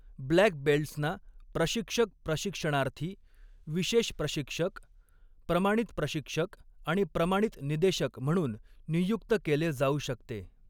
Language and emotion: Marathi, neutral